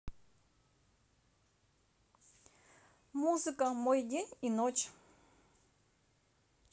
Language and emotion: Russian, neutral